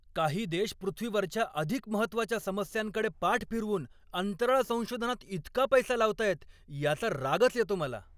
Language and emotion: Marathi, angry